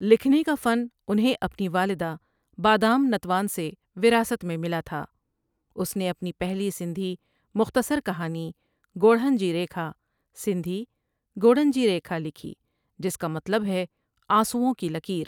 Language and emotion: Urdu, neutral